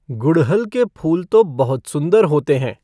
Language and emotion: Hindi, neutral